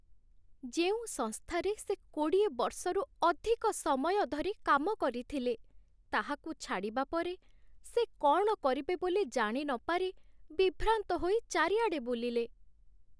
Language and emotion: Odia, sad